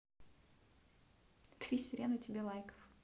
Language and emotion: Russian, positive